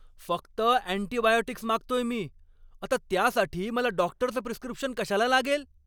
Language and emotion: Marathi, angry